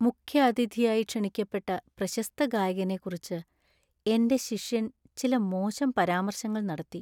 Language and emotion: Malayalam, sad